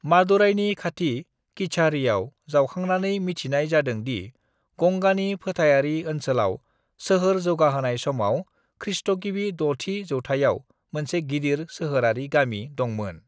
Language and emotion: Bodo, neutral